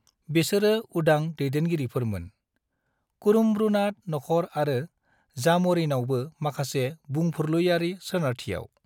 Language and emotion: Bodo, neutral